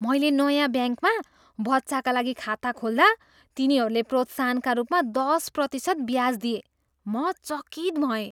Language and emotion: Nepali, surprised